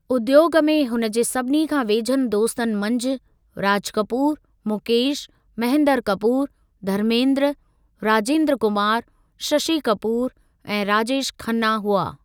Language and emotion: Sindhi, neutral